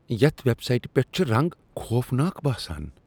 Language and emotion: Kashmiri, disgusted